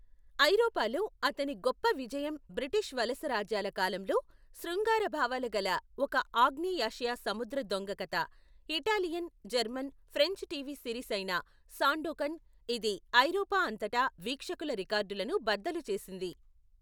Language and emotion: Telugu, neutral